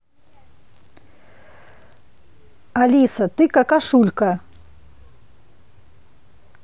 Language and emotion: Russian, angry